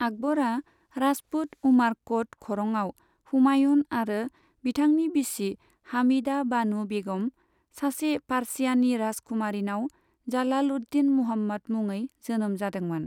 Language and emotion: Bodo, neutral